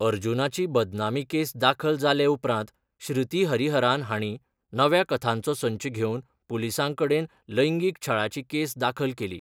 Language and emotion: Goan Konkani, neutral